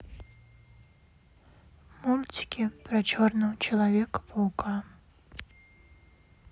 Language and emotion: Russian, sad